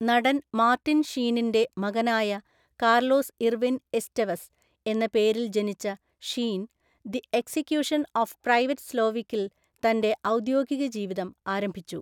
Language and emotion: Malayalam, neutral